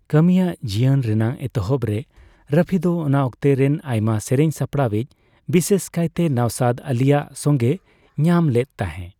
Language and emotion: Santali, neutral